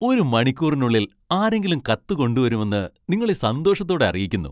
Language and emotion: Malayalam, happy